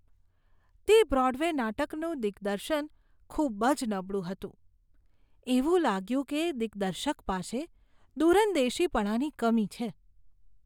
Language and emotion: Gujarati, disgusted